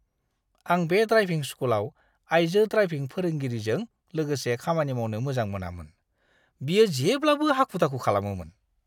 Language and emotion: Bodo, disgusted